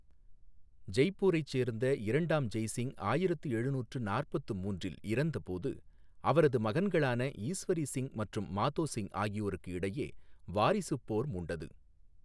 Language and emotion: Tamil, neutral